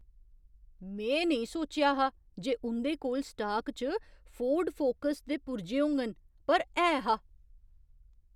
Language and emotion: Dogri, surprised